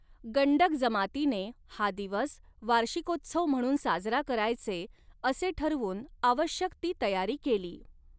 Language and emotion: Marathi, neutral